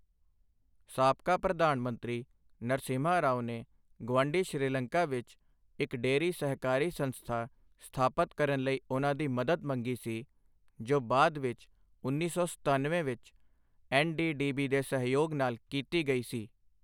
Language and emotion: Punjabi, neutral